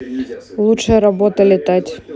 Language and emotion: Russian, neutral